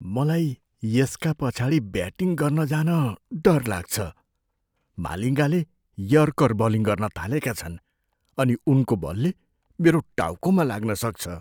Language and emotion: Nepali, fearful